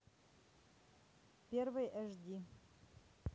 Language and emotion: Russian, neutral